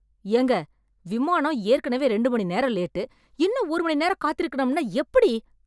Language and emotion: Tamil, angry